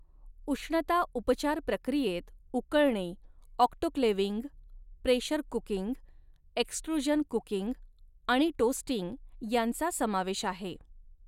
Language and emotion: Marathi, neutral